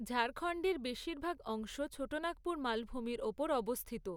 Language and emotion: Bengali, neutral